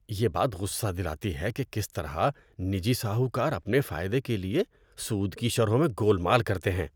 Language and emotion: Urdu, disgusted